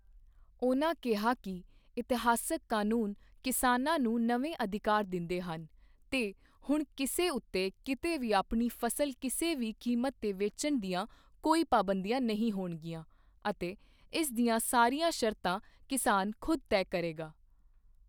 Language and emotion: Punjabi, neutral